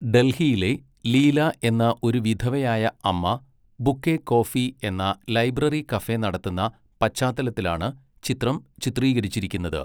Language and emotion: Malayalam, neutral